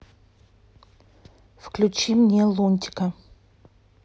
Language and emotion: Russian, neutral